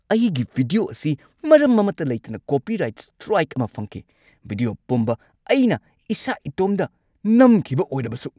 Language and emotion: Manipuri, angry